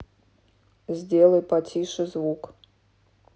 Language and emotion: Russian, neutral